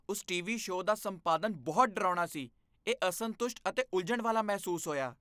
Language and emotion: Punjabi, disgusted